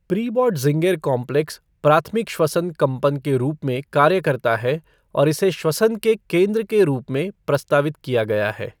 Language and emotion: Hindi, neutral